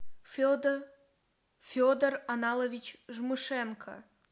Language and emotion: Russian, neutral